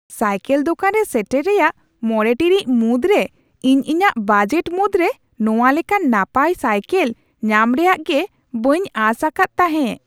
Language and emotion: Santali, surprised